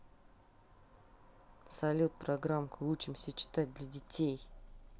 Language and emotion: Russian, neutral